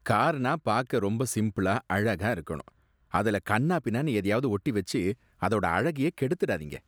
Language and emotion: Tamil, disgusted